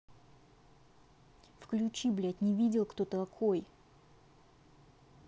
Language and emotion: Russian, angry